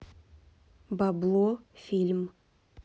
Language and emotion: Russian, neutral